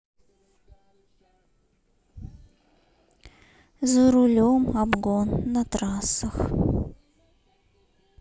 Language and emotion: Russian, sad